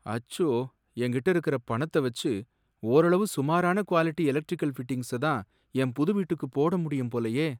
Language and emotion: Tamil, sad